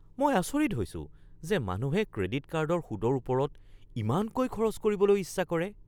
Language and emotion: Assamese, surprised